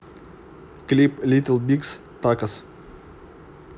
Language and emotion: Russian, neutral